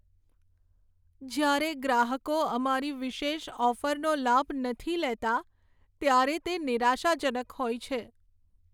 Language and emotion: Gujarati, sad